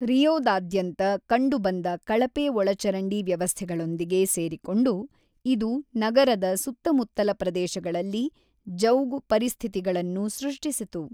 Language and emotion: Kannada, neutral